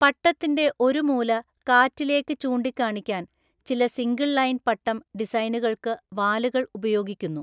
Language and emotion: Malayalam, neutral